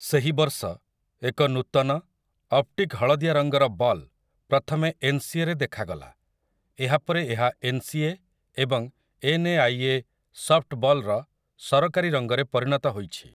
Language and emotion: Odia, neutral